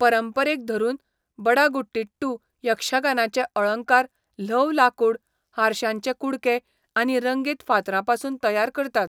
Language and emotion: Goan Konkani, neutral